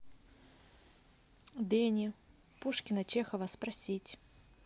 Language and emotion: Russian, neutral